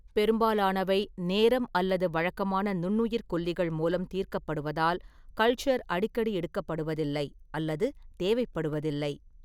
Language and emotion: Tamil, neutral